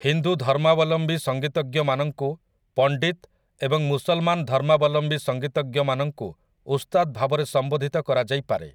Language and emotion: Odia, neutral